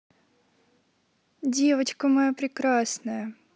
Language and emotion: Russian, positive